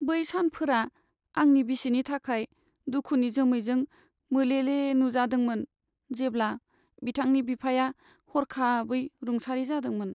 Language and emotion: Bodo, sad